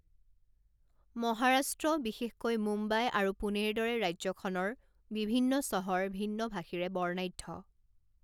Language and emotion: Assamese, neutral